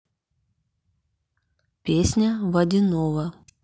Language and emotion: Russian, neutral